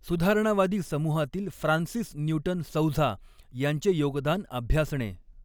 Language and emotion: Marathi, neutral